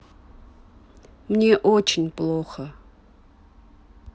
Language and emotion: Russian, sad